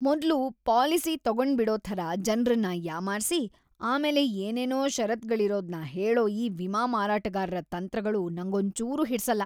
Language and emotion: Kannada, disgusted